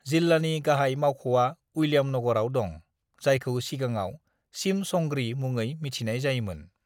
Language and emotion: Bodo, neutral